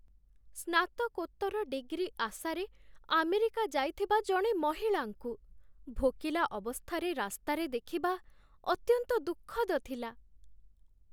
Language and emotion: Odia, sad